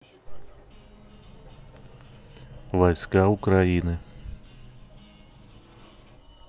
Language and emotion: Russian, neutral